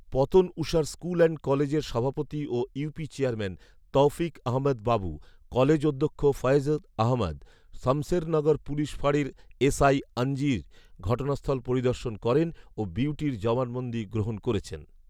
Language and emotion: Bengali, neutral